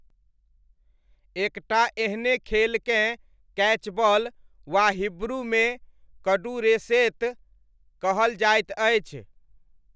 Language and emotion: Maithili, neutral